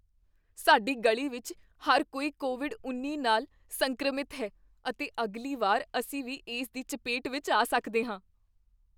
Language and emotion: Punjabi, fearful